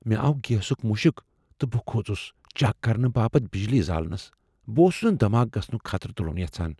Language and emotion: Kashmiri, fearful